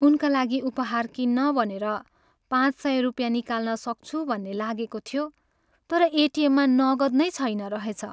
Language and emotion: Nepali, sad